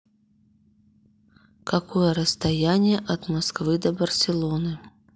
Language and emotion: Russian, neutral